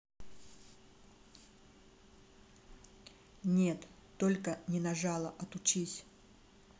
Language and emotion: Russian, neutral